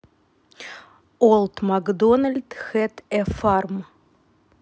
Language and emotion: Russian, neutral